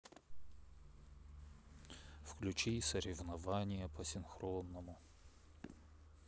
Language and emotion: Russian, sad